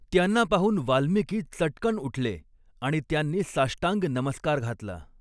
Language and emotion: Marathi, neutral